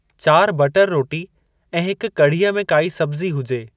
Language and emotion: Sindhi, neutral